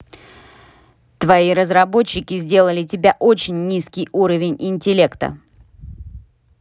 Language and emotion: Russian, angry